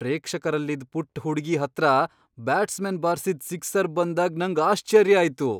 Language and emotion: Kannada, surprised